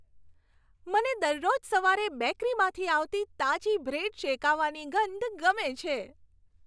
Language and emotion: Gujarati, happy